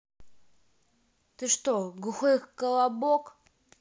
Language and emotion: Russian, angry